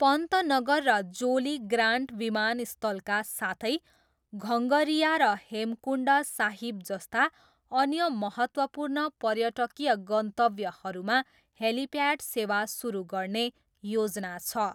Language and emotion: Nepali, neutral